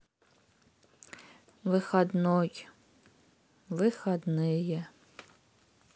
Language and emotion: Russian, sad